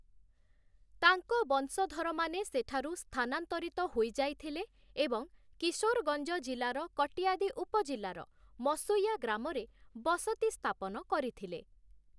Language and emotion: Odia, neutral